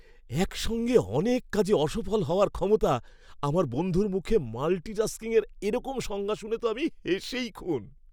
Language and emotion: Bengali, happy